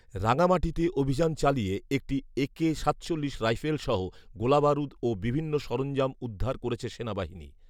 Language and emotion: Bengali, neutral